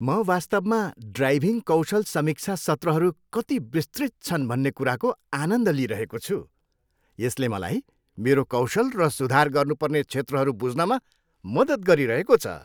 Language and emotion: Nepali, happy